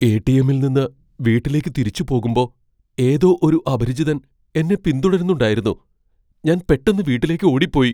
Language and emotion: Malayalam, fearful